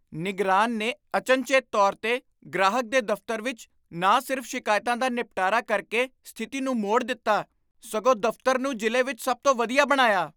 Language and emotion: Punjabi, surprised